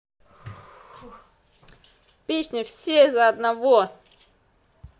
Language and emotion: Russian, positive